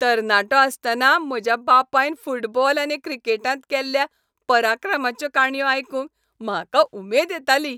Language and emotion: Goan Konkani, happy